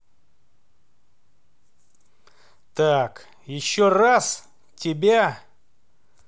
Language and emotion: Russian, angry